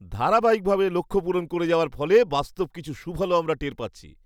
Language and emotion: Bengali, happy